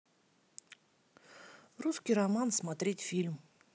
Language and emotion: Russian, neutral